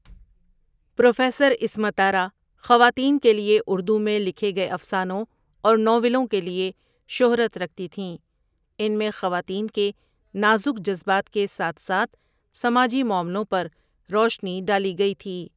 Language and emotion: Urdu, neutral